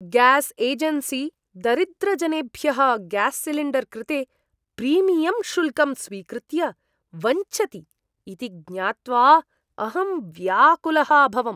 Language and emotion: Sanskrit, disgusted